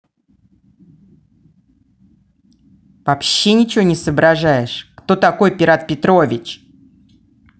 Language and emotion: Russian, angry